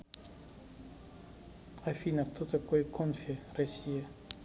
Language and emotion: Russian, neutral